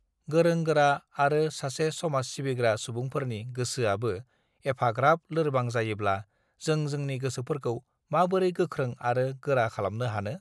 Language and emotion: Bodo, neutral